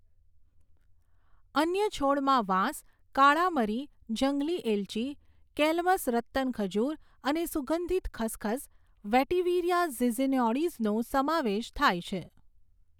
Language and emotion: Gujarati, neutral